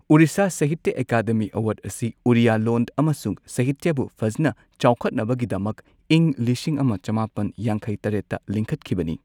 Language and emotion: Manipuri, neutral